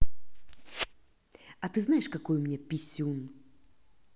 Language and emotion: Russian, angry